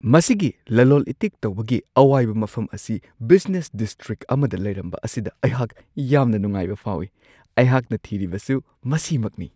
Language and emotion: Manipuri, surprised